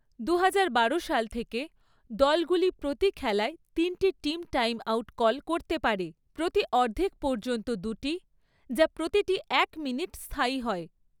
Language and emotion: Bengali, neutral